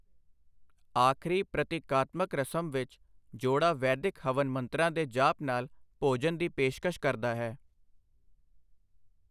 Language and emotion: Punjabi, neutral